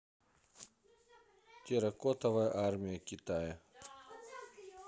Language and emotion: Russian, neutral